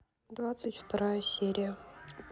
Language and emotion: Russian, neutral